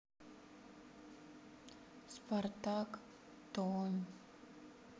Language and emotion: Russian, sad